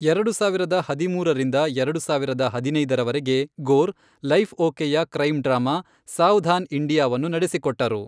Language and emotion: Kannada, neutral